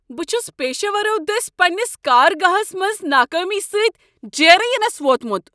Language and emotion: Kashmiri, angry